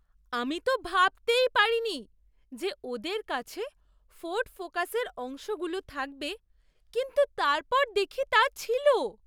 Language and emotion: Bengali, surprised